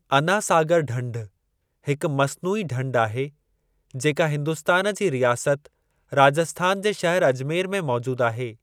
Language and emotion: Sindhi, neutral